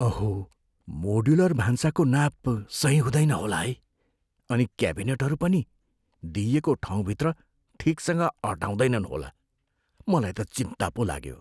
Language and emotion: Nepali, fearful